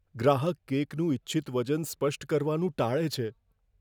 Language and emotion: Gujarati, fearful